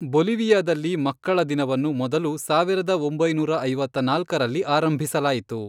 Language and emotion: Kannada, neutral